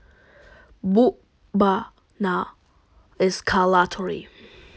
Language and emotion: Russian, neutral